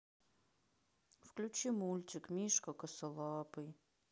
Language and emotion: Russian, sad